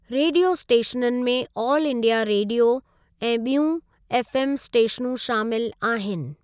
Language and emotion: Sindhi, neutral